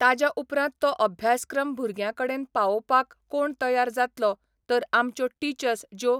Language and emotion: Goan Konkani, neutral